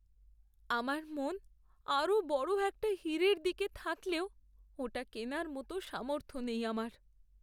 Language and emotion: Bengali, sad